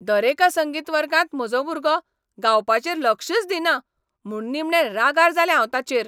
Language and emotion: Goan Konkani, angry